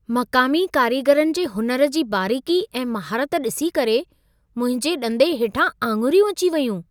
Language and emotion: Sindhi, surprised